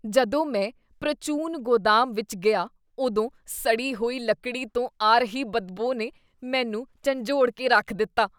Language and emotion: Punjabi, disgusted